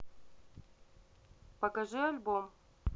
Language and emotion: Russian, neutral